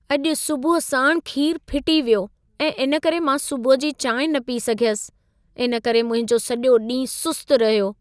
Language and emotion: Sindhi, sad